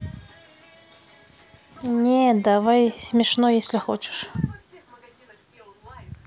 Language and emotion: Russian, neutral